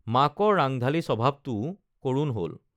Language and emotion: Assamese, neutral